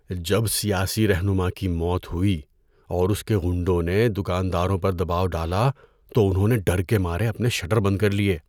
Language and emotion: Urdu, fearful